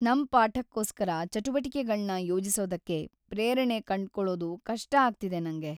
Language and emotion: Kannada, sad